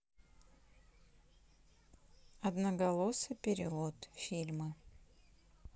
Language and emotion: Russian, neutral